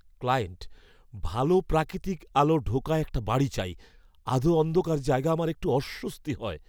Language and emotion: Bengali, fearful